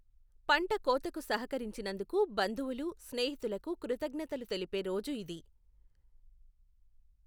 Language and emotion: Telugu, neutral